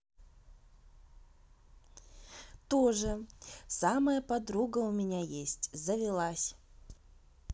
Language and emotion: Russian, positive